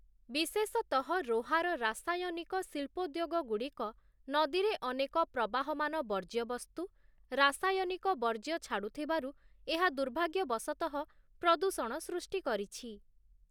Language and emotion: Odia, neutral